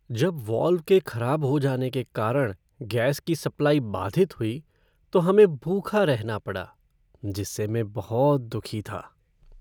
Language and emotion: Hindi, sad